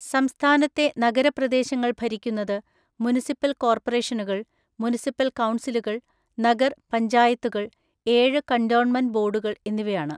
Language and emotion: Malayalam, neutral